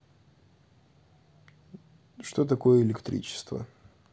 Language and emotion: Russian, neutral